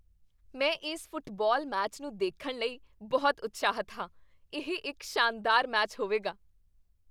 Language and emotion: Punjabi, happy